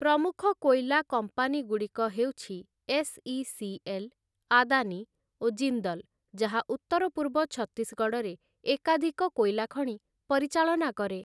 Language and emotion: Odia, neutral